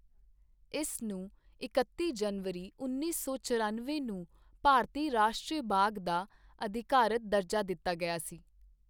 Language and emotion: Punjabi, neutral